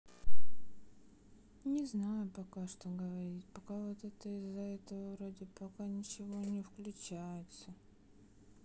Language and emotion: Russian, sad